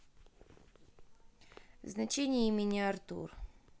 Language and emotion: Russian, neutral